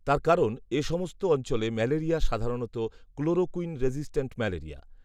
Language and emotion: Bengali, neutral